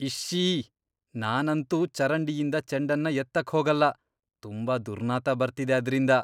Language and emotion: Kannada, disgusted